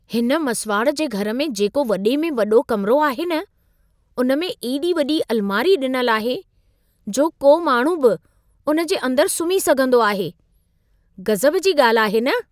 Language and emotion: Sindhi, surprised